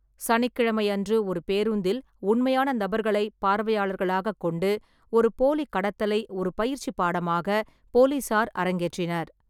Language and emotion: Tamil, neutral